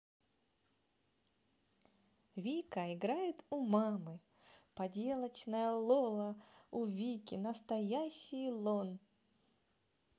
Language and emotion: Russian, positive